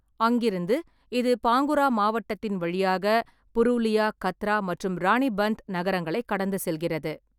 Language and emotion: Tamil, neutral